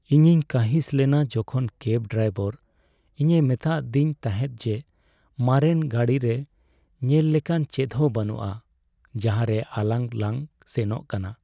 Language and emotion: Santali, sad